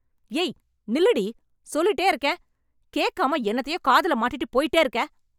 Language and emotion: Tamil, angry